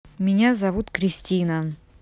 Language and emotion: Russian, neutral